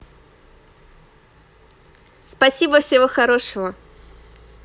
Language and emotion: Russian, positive